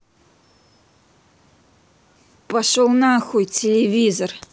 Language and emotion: Russian, angry